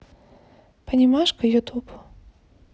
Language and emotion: Russian, neutral